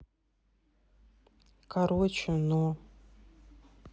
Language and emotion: Russian, neutral